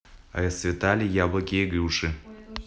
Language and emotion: Russian, neutral